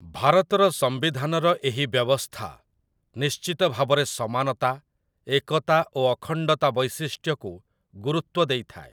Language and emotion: Odia, neutral